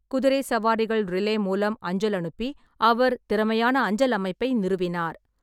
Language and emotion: Tamil, neutral